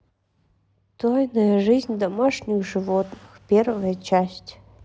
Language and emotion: Russian, sad